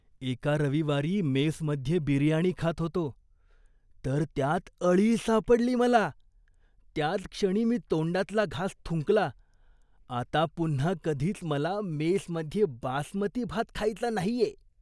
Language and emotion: Marathi, disgusted